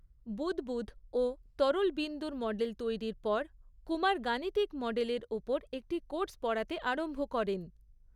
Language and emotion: Bengali, neutral